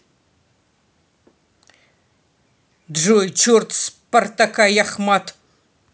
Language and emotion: Russian, angry